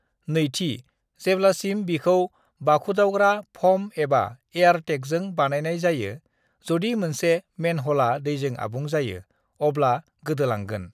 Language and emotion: Bodo, neutral